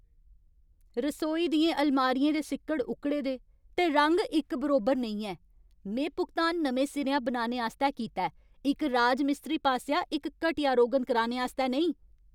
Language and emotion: Dogri, angry